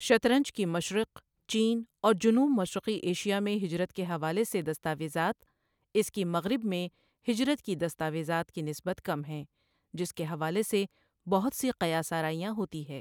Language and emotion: Urdu, neutral